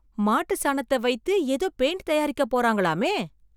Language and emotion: Tamil, surprised